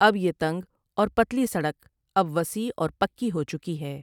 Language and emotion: Urdu, neutral